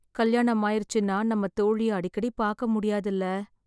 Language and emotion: Tamil, sad